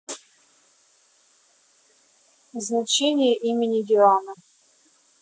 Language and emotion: Russian, neutral